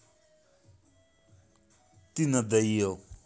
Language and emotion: Russian, angry